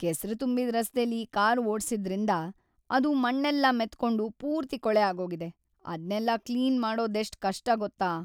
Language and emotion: Kannada, sad